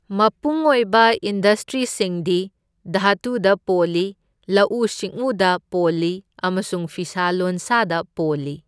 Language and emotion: Manipuri, neutral